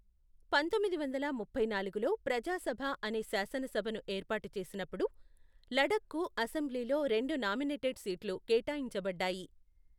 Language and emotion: Telugu, neutral